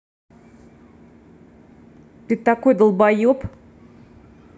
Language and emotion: Russian, angry